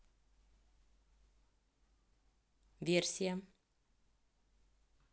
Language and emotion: Russian, neutral